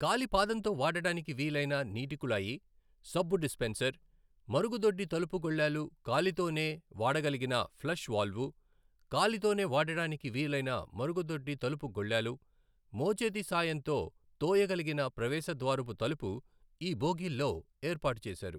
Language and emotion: Telugu, neutral